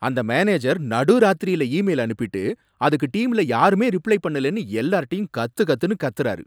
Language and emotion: Tamil, angry